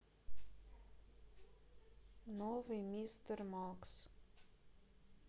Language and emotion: Russian, sad